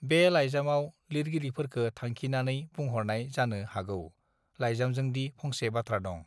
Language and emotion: Bodo, neutral